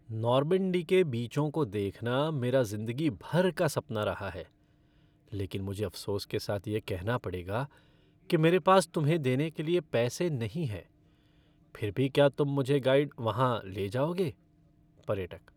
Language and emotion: Hindi, sad